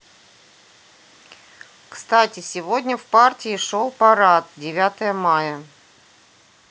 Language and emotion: Russian, neutral